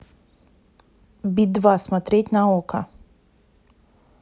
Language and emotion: Russian, neutral